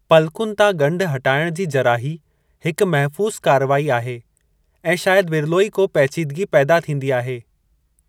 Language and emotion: Sindhi, neutral